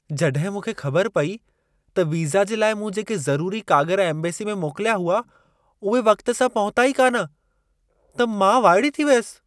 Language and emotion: Sindhi, surprised